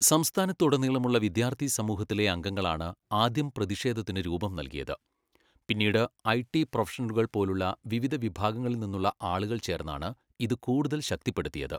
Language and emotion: Malayalam, neutral